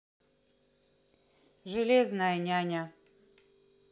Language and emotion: Russian, neutral